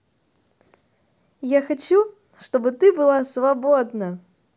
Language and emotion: Russian, positive